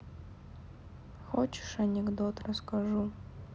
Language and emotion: Russian, sad